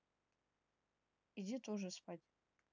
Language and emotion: Russian, neutral